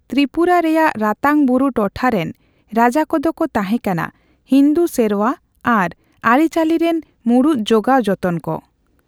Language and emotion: Santali, neutral